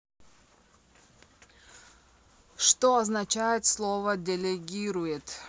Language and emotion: Russian, neutral